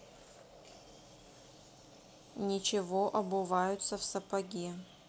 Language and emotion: Russian, neutral